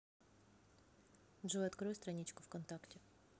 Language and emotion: Russian, neutral